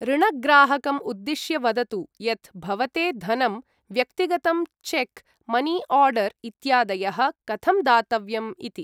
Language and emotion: Sanskrit, neutral